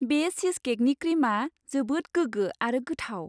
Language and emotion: Bodo, happy